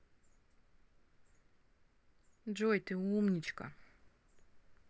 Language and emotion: Russian, positive